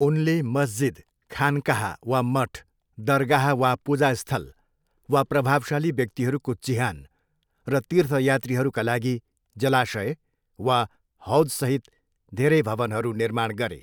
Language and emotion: Nepali, neutral